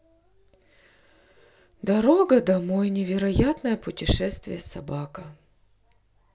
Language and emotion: Russian, sad